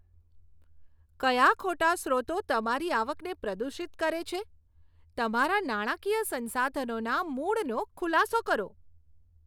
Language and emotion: Gujarati, disgusted